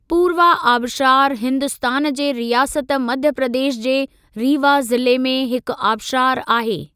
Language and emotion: Sindhi, neutral